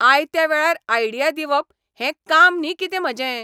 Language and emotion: Goan Konkani, angry